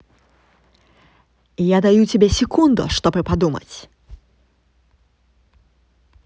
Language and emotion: Russian, angry